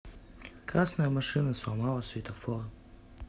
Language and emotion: Russian, neutral